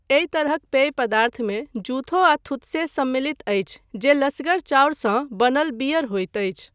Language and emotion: Maithili, neutral